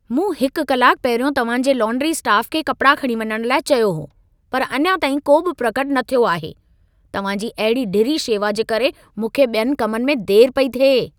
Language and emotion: Sindhi, angry